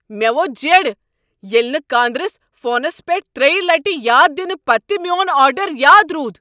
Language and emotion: Kashmiri, angry